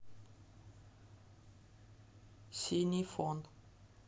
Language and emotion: Russian, neutral